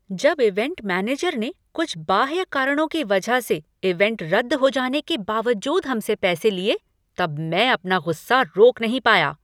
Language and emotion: Hindi, angry